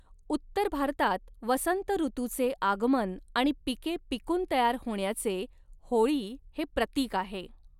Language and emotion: Marathi, neutral